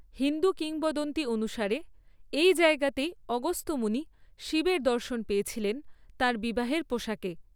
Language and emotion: Bengali, neutral